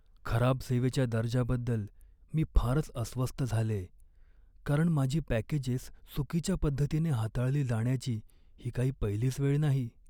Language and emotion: Marathi, sad